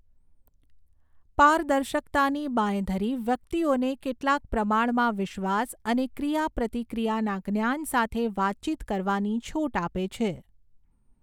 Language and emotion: Gujarati, neutral